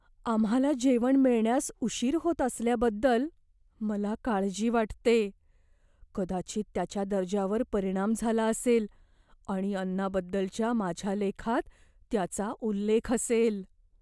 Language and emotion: Marathi, fearful